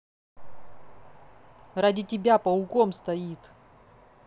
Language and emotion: Russian, angry